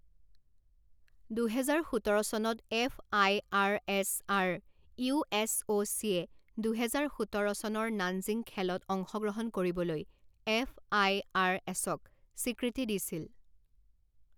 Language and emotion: Assamese, neutral